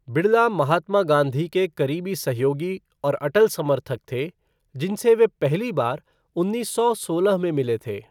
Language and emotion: Hindi, neutral